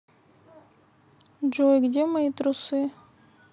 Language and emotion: Russian, neutral